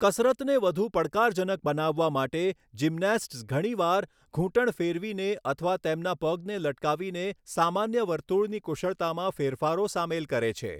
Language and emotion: Gujarati, neutral